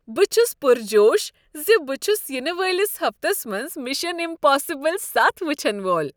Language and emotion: Kashmiri, happy